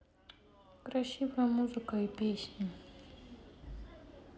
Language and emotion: Russian, sad